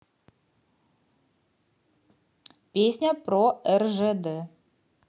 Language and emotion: Russian, positive